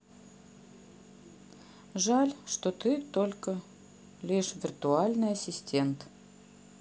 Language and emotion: Russian, sad